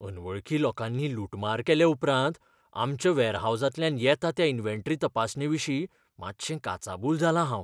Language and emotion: Goan Konkani, fearful